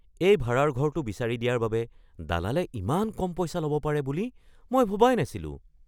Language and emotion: Assamese, surprised